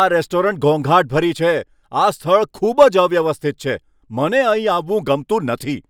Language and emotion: Gujarati, angry